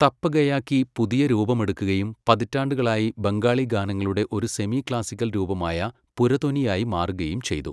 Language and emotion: Malayalam, neutral